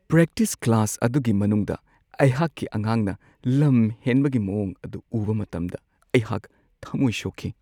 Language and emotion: Manipuri, sad